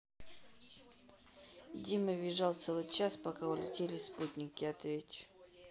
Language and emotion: Russian, neutral